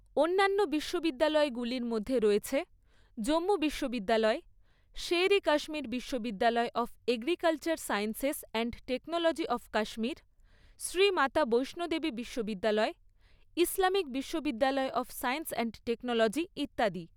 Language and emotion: Bengali, neutral